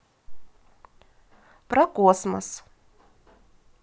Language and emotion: Russian, positive